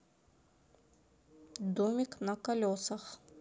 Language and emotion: Russian, neutral